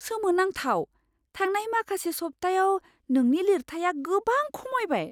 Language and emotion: Bodo, surprised